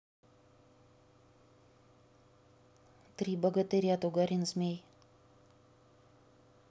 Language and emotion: Russian, neutral